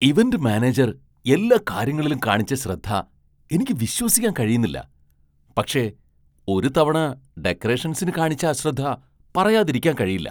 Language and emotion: Malayalam, surprised